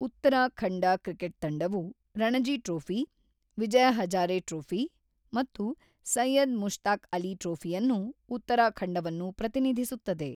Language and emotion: Kannada, neutral